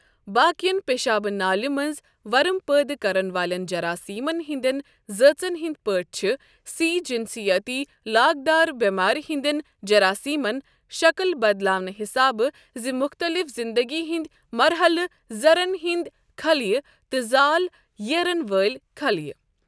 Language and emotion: Kashmiri, neutral